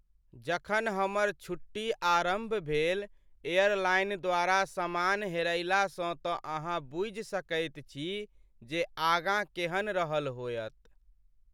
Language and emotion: Maithili, sad